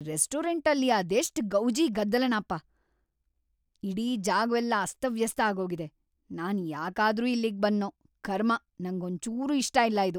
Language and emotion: Kannada, angry